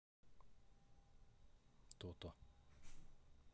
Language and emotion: Russian, neutral